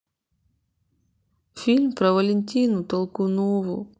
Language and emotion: Russian, sad